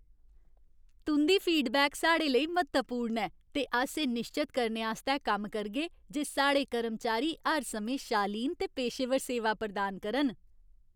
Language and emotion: Dogri, happy